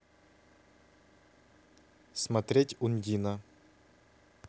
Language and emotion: Russian, neutral